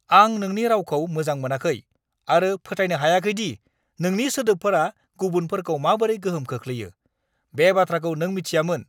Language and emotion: Bodo, angry